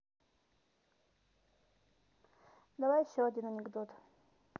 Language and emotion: Russian, neutral